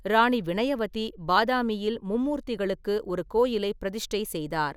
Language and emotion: Tamil, neutral